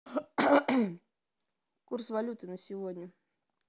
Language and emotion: Russian, neutral